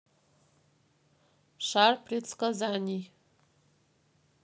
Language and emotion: Russian, neutral